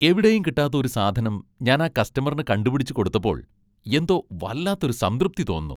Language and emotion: Malayalam, happy